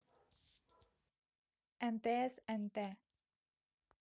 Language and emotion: Russian, neutral